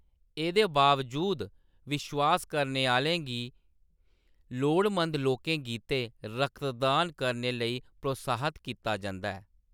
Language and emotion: Dogri, neutral